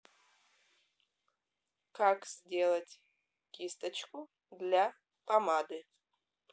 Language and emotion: Russian, neutral